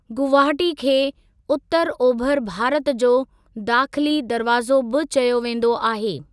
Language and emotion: Sindhi, neutral